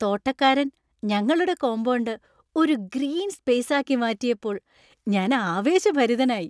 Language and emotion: Malayalam, happy